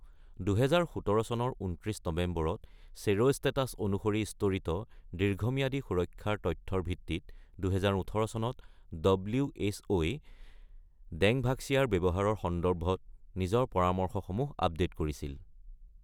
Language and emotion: Assamese, neutral